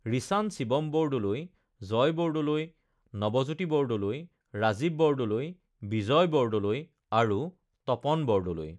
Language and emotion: Assamese, neutral